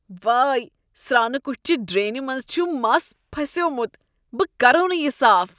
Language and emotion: Kashmiri, disgusted